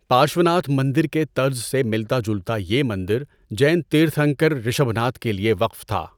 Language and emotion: Urdu, neutral